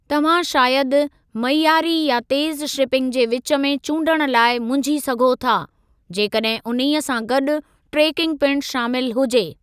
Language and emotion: Sindhi, neutral